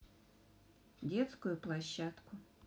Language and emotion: Russian, neutral